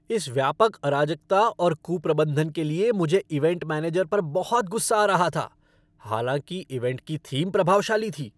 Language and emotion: Hindi, angry